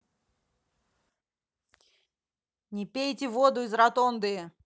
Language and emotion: Russian, angry